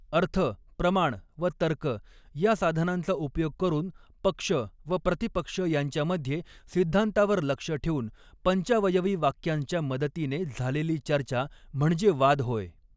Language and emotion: Marathi, neutral